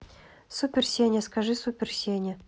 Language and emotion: Russian, neutral